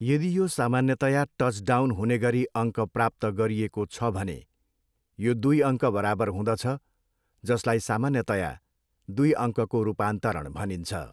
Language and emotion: Nepali, neutral